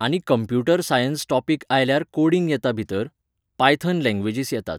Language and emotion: Goan Konkani, neutral